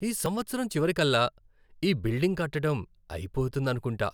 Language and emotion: Telugu, happy